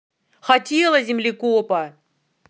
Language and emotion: Russian, angry